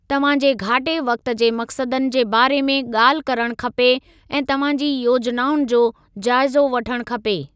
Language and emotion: Sindhi, neutral